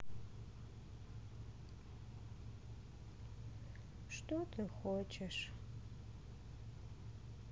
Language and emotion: Russian, sad